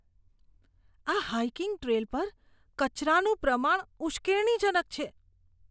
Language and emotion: Gujarati, disgusted